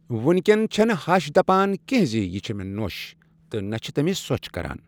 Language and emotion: Kashmiri, neutral